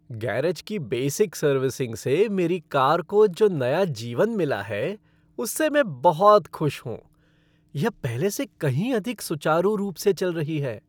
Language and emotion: Hindi, happy